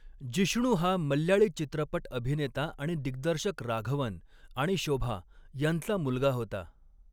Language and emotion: Marathi, neutral